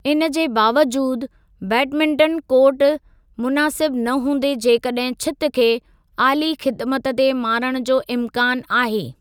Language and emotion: Sindhi, neutral